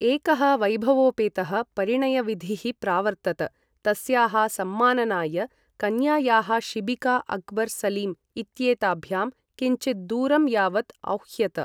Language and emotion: Sanskrit, neutral